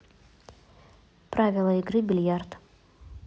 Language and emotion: Russian, neutral